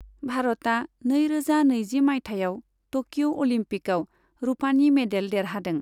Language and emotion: Bodo, neutral